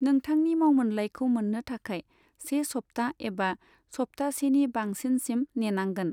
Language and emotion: Bodo, neutral